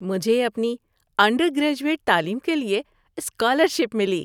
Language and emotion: Urdu, happy